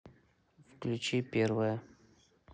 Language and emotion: Russian, neutral